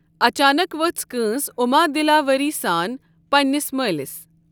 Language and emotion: Kashmiri, neutral